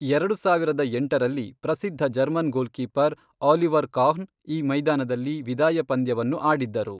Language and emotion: Kannada, neutral